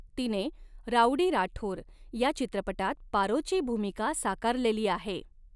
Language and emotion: Marathi, neutral